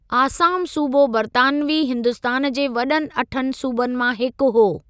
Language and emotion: Sindhi, neutral